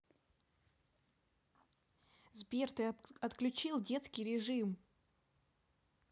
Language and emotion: Russian, neutral